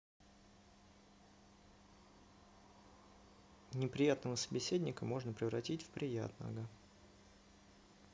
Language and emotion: Russian, neutral